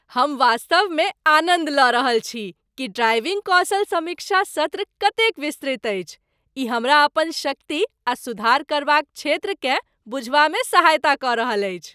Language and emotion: Maithili, happy